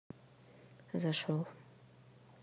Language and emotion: Russian, neutral